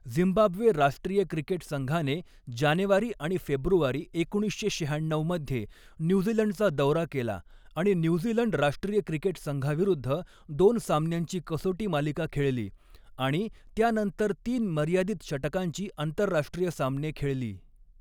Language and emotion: Marathi, neutral